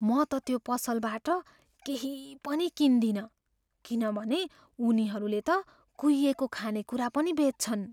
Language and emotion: Nepali, fearful